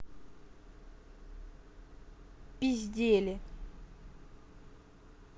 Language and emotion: Russian, angry